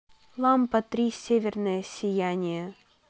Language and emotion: Russian, neutral